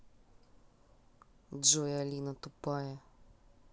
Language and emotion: Russian, neutral